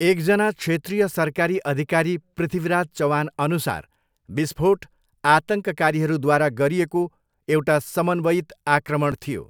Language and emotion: Nepali, neutral